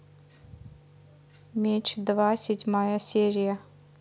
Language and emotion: Russian, neutral